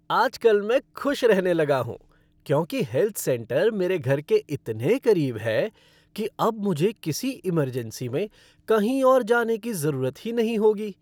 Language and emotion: Hindi, happy